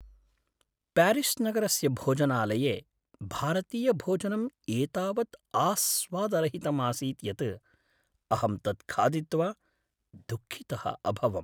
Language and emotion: Sanskrit, sad